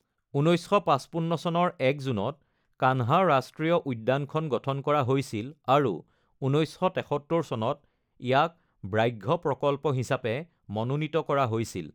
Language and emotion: Assamese, neutral